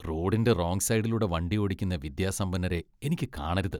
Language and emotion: Malayalam, disgusted